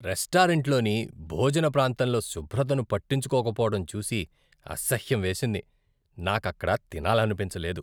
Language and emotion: Telugu, disgusted